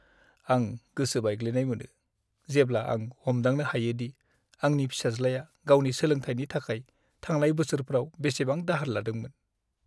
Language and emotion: Bodo, sad